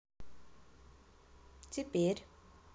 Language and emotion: Russian, neutral